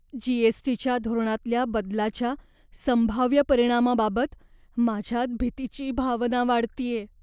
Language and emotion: Marathi, fearful